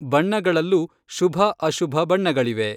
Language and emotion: Kannada, neutral